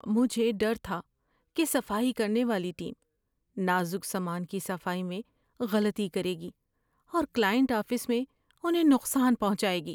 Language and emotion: Urdu, fearful